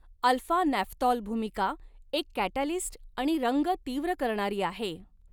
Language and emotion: Marathi, neutral